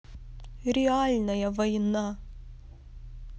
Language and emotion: Russian, sad